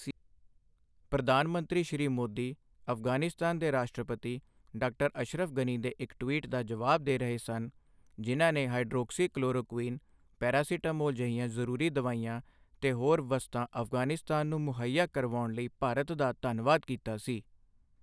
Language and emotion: Punjabi, neutral